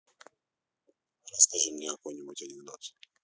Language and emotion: Russian, neutral